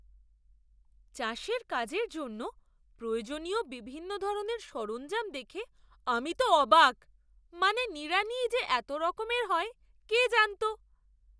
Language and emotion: Bengali, surprised